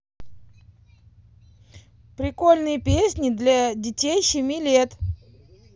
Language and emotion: Russian, positive